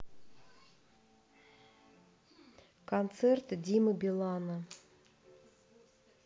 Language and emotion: Russian, neutral